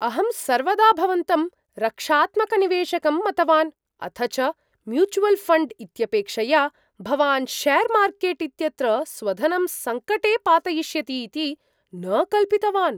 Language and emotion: Sanskrit, surprised